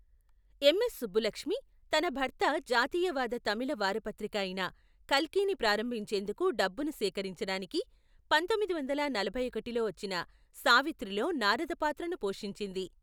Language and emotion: Telugu, neutral